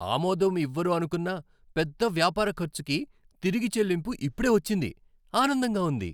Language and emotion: Telugu, happy